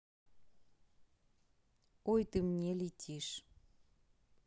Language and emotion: Russian, neutral